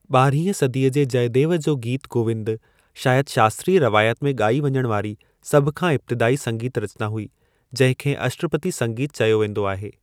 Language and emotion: Sindhi, neutral